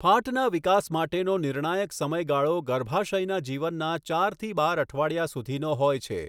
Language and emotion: Gujarati, neutral